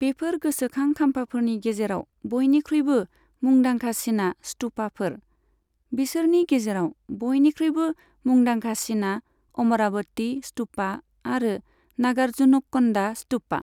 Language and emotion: Bodo, neutral